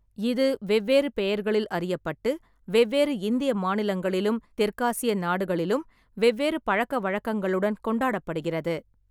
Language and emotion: Tamil, neutral